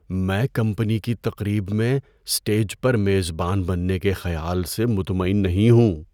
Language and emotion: Urdu, fearful